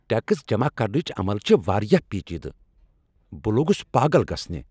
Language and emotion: Kashmiri, angry